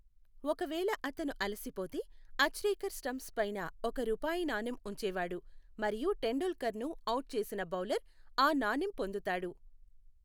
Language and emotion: Telugu, neutral